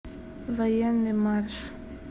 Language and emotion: Russian, neutral